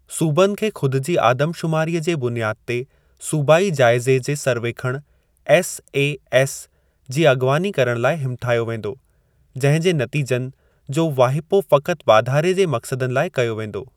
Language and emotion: Sindhi, neutral